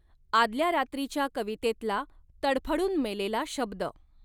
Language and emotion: Marathi, neutral